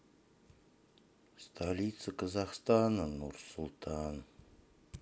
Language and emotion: Russian, sad